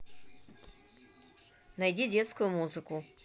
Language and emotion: Russian, neutral